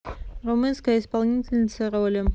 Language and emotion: Russian, neutral